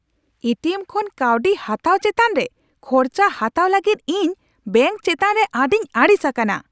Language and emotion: Santali, angry